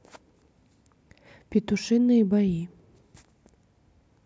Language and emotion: Russian, neutral